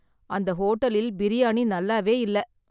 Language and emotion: Tamil, sad